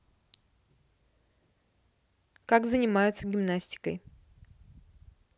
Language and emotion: Russian, neutral